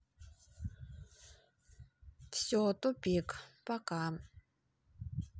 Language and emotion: Russian, sad